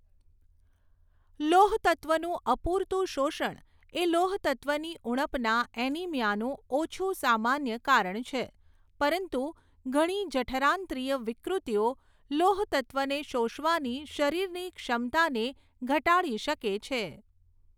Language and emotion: Gujarati, neutral